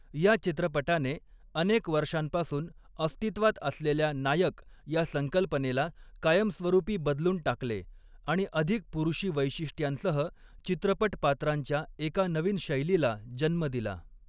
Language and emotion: Marathi, neutral